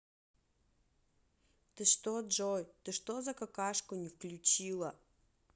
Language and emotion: Russian, angry